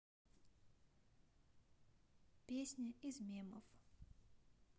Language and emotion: Russian, neutral